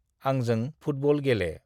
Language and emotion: Bodo, neutral